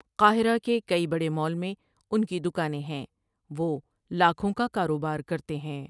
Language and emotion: Urdu, neutral